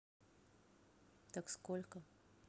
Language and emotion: Russian, neutral